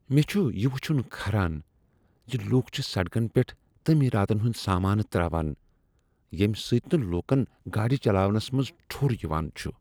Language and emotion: Kashmiri, disgusted